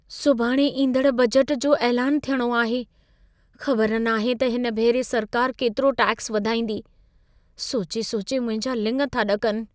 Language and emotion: Sindhi, fearful